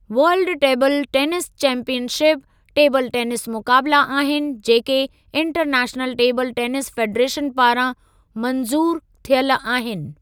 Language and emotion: Sindhi, neutral